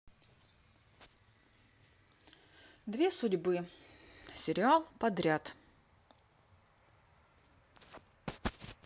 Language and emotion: Russian, neutral